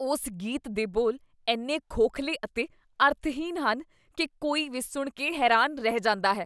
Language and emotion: Punjabi, disgusted